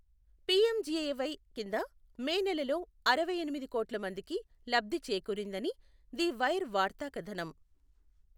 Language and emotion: Telugu, neutral